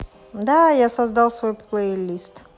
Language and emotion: Russian, positive